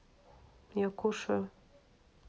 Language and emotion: Russian, neutral